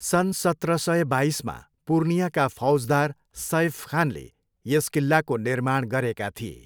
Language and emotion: Nepali, neutral